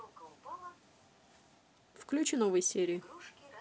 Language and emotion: Russian, neutral